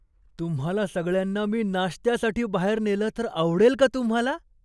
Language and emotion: Marathi, surprised